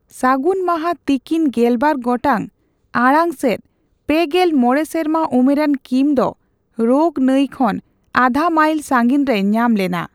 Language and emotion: Santali, neutral